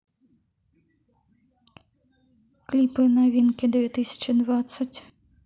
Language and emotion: Russian, neutral